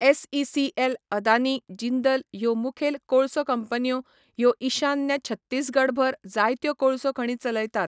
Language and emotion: Goan Konkani, neutral